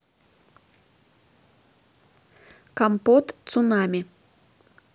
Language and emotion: Russian, neutral